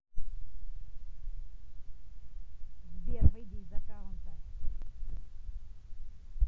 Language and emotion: Russian, neutral